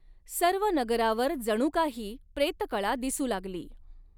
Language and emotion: Marathi, neutral